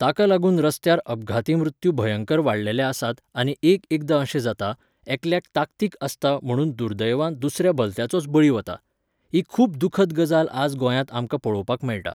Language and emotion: Goan Konkani, neutral